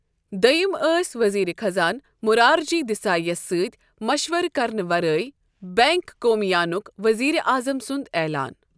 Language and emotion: Kashmiri, neutral